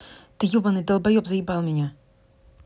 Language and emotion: Russian, angry